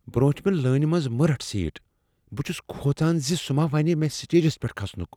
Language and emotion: Kashmiri, fearful